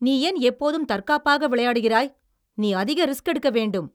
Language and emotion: Tamil, angry